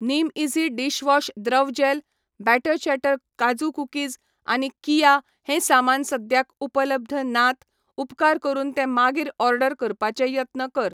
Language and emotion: Goan Konkani, neutral